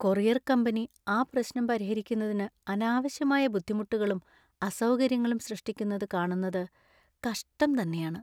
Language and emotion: Malayalam, sad